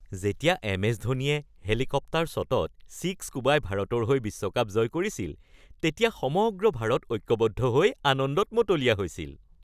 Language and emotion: Assamese, happy